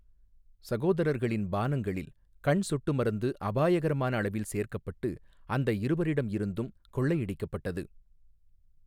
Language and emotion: Tamil, neutral